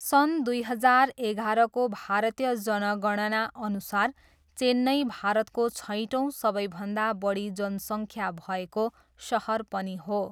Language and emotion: Nepali, neutral